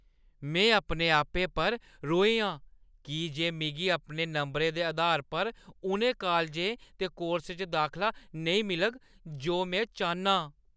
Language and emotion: Dogri, angry